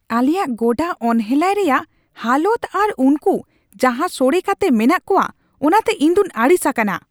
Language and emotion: Santali, angry